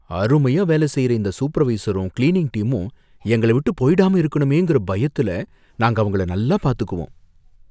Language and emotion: Tamil, fearful